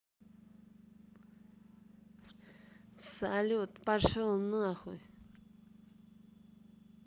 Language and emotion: Russian, angry